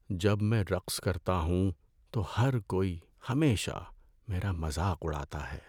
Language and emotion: Urdu, sad